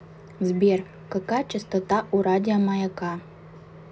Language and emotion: Russian, neutral